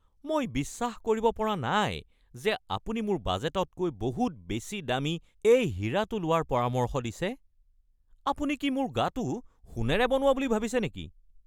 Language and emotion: Assamese, angry